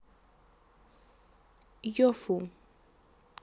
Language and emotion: Russian, neutral